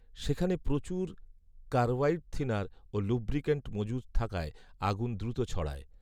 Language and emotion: Bengali, neutral